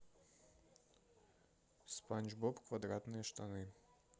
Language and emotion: Russian, neutral